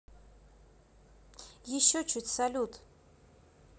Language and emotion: Russian, neutral